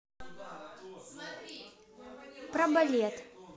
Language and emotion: Russian, neutral